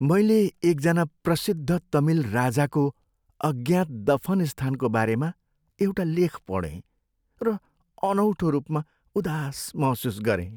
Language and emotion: Nepali, sad